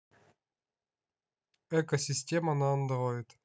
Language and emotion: Russian, neutral